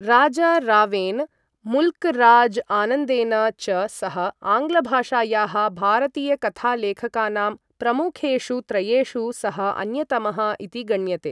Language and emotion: Sanskrit, neutral